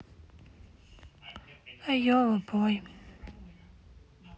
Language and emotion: Russian, sad